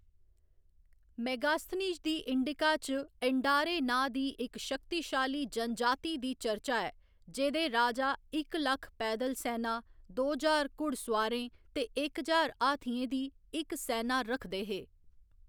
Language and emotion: Dogri, neutral